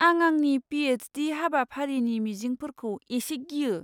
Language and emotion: Bodo, fearful